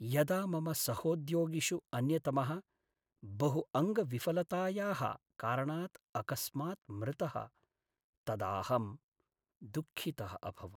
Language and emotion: Sanskrit, sad